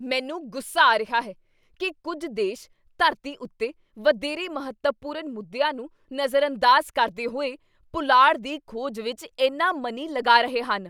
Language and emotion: Punjabi, angry